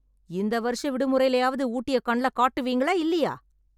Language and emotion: Tamil, angry